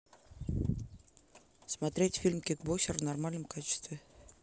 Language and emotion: Russian, neutral